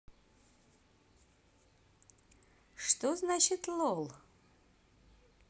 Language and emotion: Russian, positive